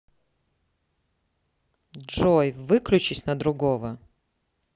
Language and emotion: Russian, neutral